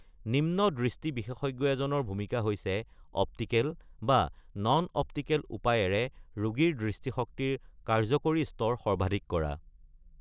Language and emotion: Assamese, neutral